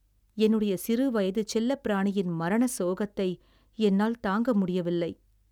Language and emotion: Tamil, sad